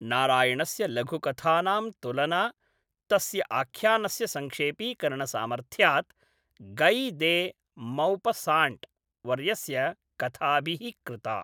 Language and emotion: Sanskrit, neutral